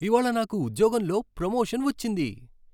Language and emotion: Telugu, happy